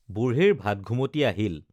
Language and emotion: Assamese, neutral